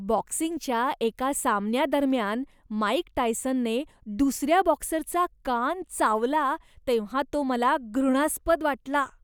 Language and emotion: Marathi, disgusted